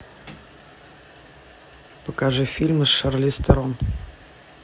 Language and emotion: Russian, neutral